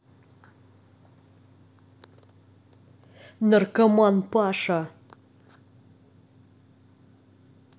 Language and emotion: Russian, angry